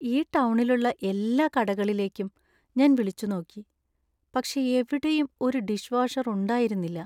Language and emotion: Malayalam, sad